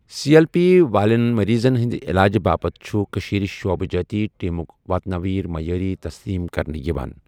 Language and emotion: Kashmiri, neutral